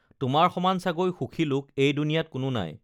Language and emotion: Assamese, neutral